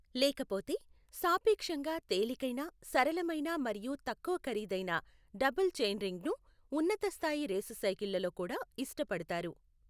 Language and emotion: Telugu, neutral